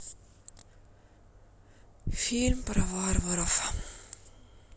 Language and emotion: Russian, sad